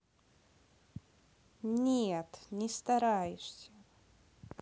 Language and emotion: Russian, neutral